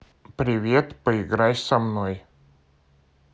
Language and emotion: Russian, neutral